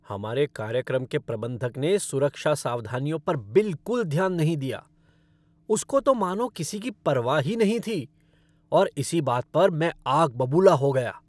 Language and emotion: Hindi, angry